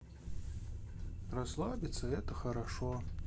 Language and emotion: Russian, neutral